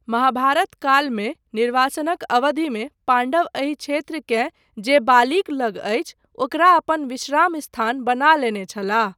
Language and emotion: Maithili, neutral